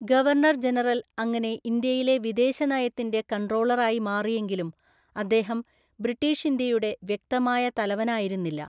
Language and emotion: Malayalam, neutral